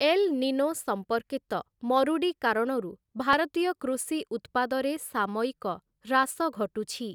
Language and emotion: Odia, neutral